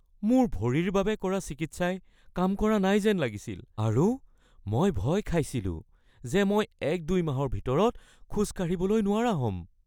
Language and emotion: Assamese, fearful